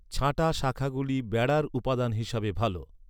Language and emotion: Bengali, neutral